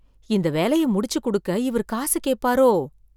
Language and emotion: Tamil, fearful